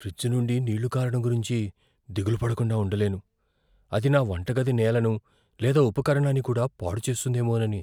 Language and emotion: Telugu, fearful